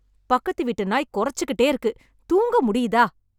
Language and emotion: Tamil, angry